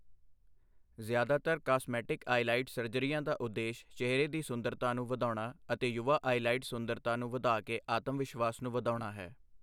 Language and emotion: Punjabi, neutral